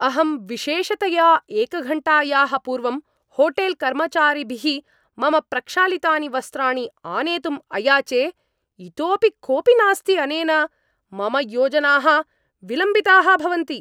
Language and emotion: Sanskrit, angry